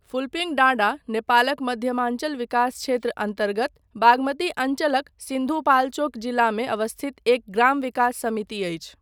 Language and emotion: Maithili, neutral